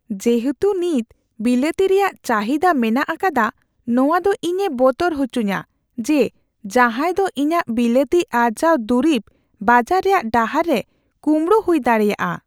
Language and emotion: Santali, fearful